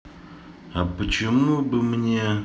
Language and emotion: Russian, neutral